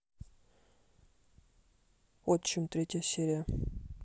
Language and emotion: Russian, neutral